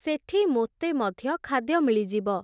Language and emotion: Odia, neutral